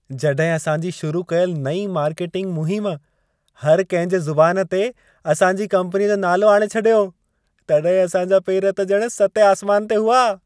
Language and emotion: Sindhi, happy